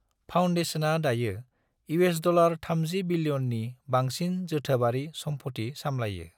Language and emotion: Bodo, neutral